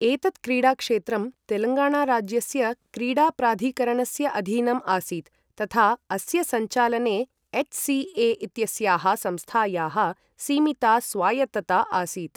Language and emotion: Sanskrit, neutral